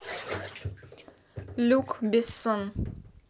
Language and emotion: Russian, neutral